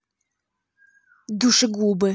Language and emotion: Russian, angry